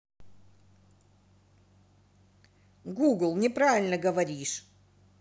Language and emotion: Russian, angry